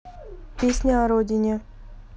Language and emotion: Russian, neutral